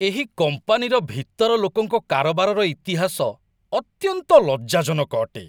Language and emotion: Odia, disgusted